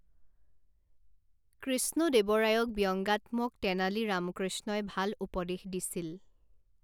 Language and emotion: Assamese, neutral